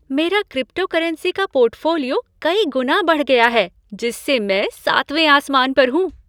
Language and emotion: Hindi, happy